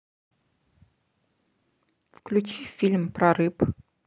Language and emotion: Russian, neutral